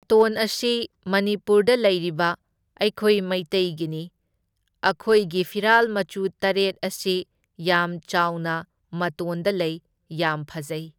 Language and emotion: Manipuri, neutral